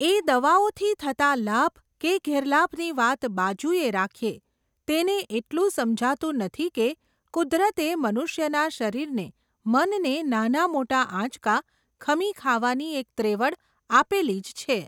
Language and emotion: Gujarati, neutral